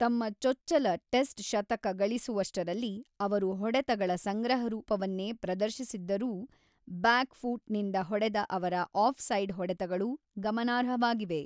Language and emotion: Kannada, neutral